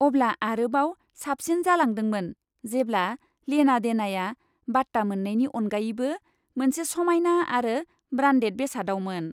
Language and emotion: Bodo, happy